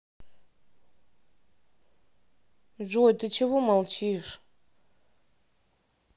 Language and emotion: Russian, sad